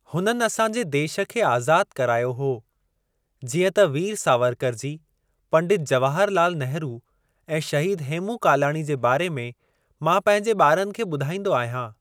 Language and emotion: Sindhi, neutral